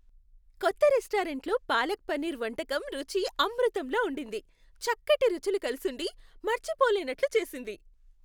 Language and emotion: Telugu, happy